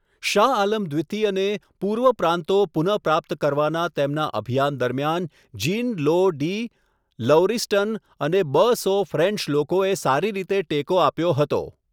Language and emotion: Gujarati, neutral